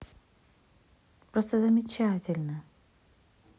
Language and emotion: Russian, positive